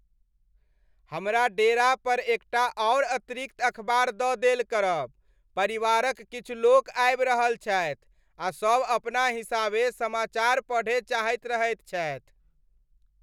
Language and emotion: Maithili, happy